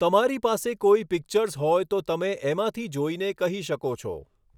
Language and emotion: Gujarati, neutral